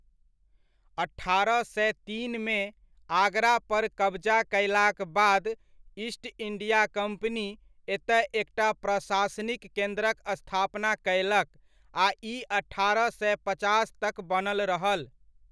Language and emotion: Maithili, neutral